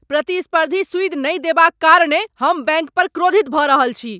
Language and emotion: Maithili, angry